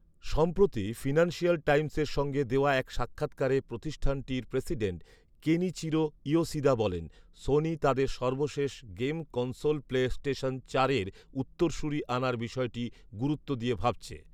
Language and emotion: Bengali, neutral